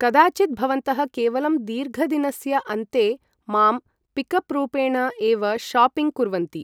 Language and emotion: Sanskrit, neutral